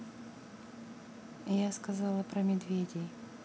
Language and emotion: Russian, angry